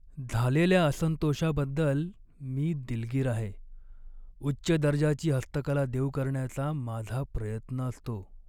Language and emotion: Marathi, sad